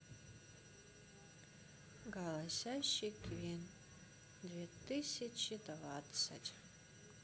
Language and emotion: Russian, sad